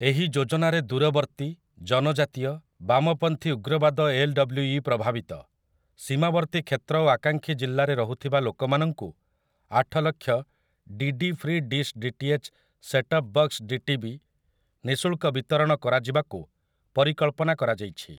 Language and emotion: Odia, neutral